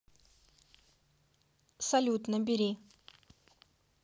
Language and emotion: Russian, neutral